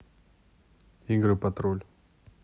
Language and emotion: Russian, neutral